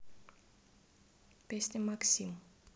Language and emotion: Russian, neutral